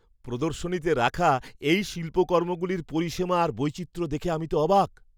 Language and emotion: Bengali, surprised